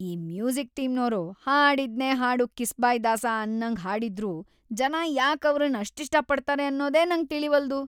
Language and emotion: Kannada, disgusted